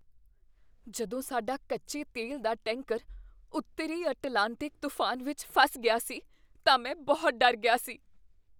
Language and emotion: Punjabi, fearful